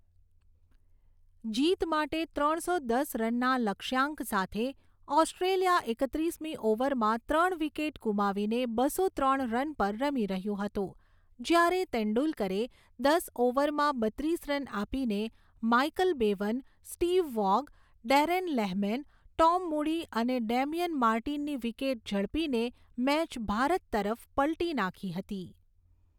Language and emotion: Gujarati, neutral